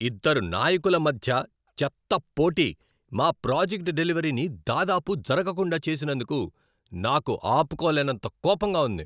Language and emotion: Telugu, angry